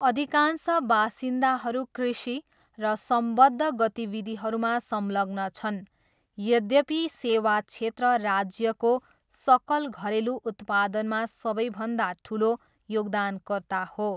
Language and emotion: Nepali, neutral